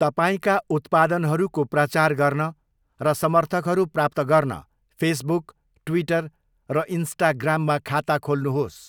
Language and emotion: Nepali, neutral